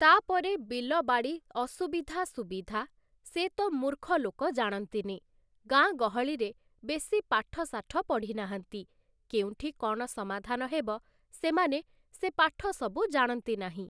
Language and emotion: Odia, neutral